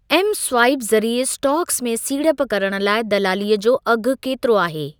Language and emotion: Sindhi, neutral